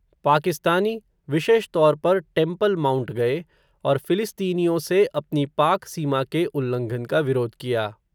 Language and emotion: Hindi, neutral